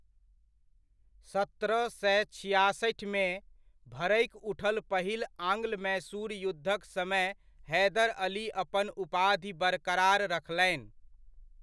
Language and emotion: Maithili, neutral